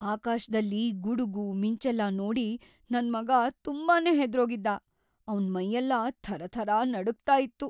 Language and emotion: Kannada, fearful